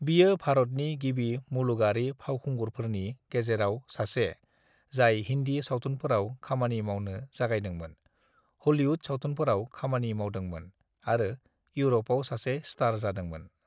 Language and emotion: Bodo, neutral